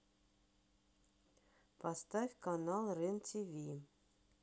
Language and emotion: Russian, neutral